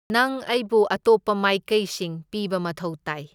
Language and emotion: Manipuri, neutral